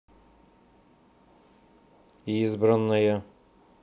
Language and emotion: Russian, neutral